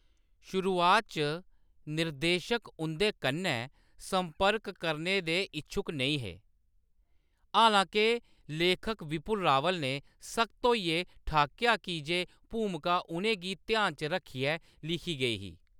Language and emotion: Dogri, neutral